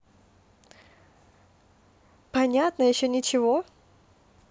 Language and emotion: Russian, neutral